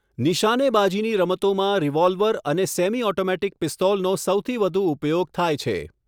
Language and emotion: Gujarati, neutral